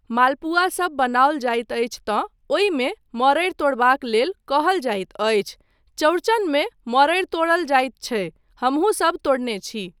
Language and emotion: Maithili, neutral